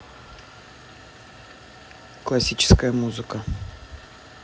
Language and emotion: Russian, neutral